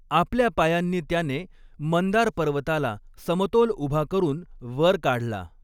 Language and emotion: Marathi, neutral